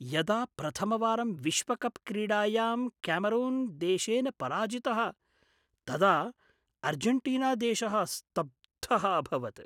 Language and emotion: Sanskrit, surprised